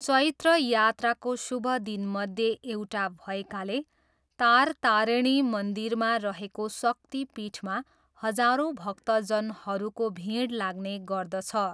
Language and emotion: Nepali, neutral